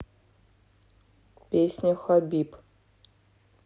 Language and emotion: Russian, neutral